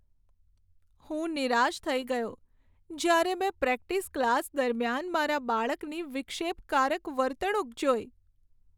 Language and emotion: Gujarati, sad